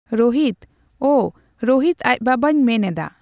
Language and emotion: Santali, neutral